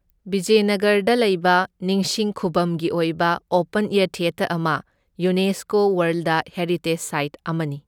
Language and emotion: Manipuri, neutral